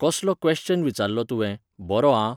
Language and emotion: Goan Konkani, neutral